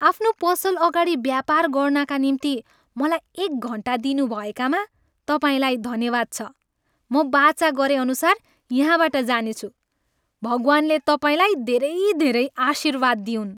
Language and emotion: Nepali, happy